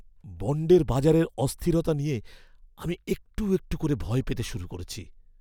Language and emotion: Bengali, fearful